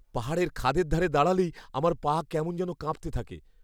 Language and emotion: Bengali, fearful